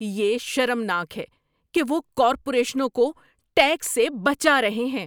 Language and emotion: Urdu, angry